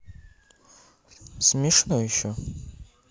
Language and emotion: Russian, neutral